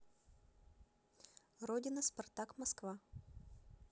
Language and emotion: Russian, neutral